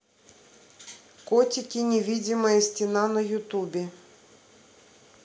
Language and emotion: Russian, neutral